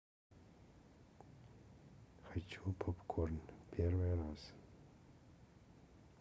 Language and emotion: Russian, neutral